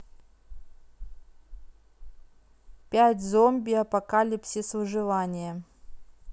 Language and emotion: Russian, neutral